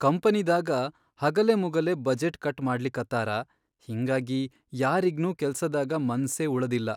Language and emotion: Kannada, sad